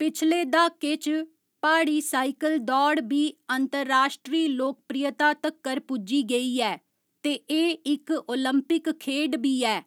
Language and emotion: Dogri, neutral